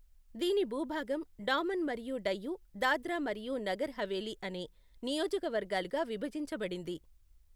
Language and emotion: Telugu, neutral